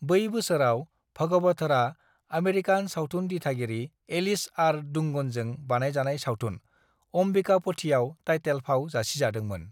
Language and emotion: Bodo, neutral